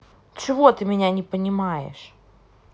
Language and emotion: Russian, angry